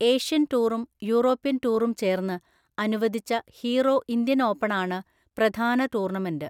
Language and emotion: Malayalam, neutral